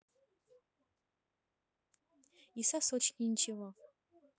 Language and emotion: Russian, neutral